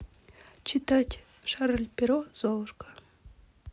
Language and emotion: Russian, neutral